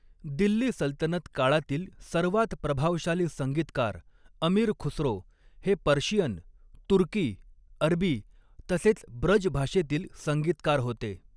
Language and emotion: Marathi, neutral